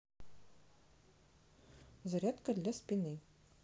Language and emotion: Russian, neutral